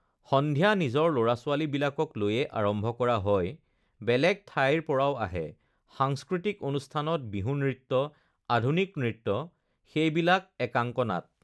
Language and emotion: Assamese, neutral